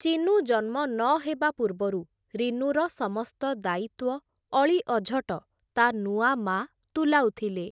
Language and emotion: Odia, neutral